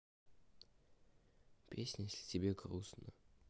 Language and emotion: Russian, sad